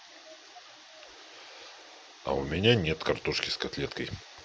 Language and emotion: Russian, neutral